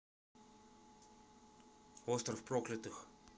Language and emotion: Russian, neutral